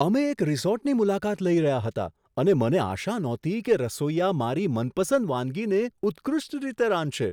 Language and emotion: Gujarati, surprised